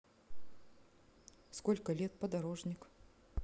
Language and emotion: Russian, neutral